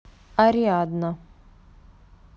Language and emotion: Russian, neutral